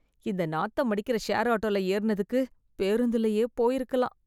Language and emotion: Tamil, disgusted